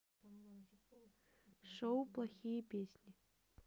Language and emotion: Russian, neutral